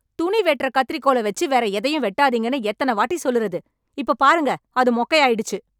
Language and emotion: Tamil, angry